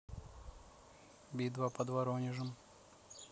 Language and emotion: Russian, neutral